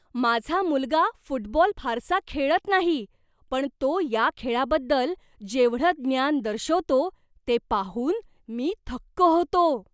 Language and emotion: Marathi, surprised